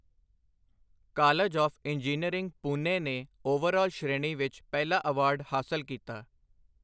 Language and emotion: Punjabi, neutral